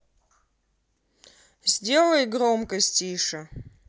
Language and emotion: Russian, neutral